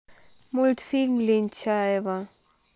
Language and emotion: Russian, neutral